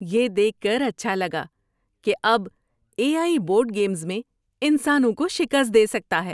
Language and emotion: Urdu, happy